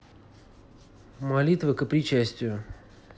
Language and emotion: Russian, neutral